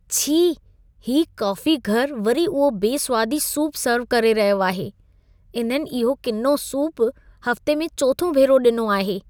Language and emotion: Sindhi, disgusted